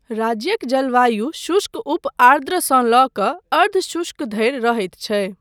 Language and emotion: Maithili, neutral